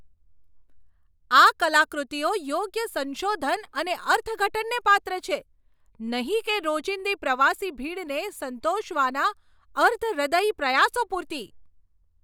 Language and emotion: Gujarati, angry